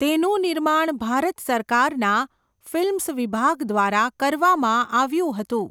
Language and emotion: Gujarati, neutral